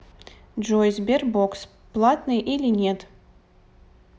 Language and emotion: Russian, neutral